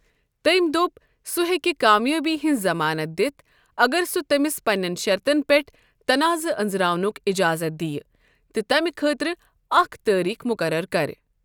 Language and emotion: Kashmiri, neutral